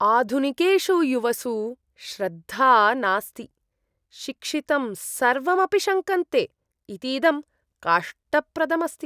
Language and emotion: Sanskrit, disgusted